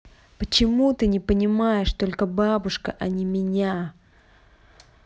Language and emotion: Russian, angry